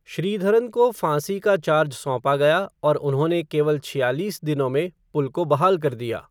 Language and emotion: Hindi, neutral